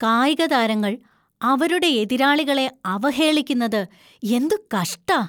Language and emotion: Malayalam, disgusted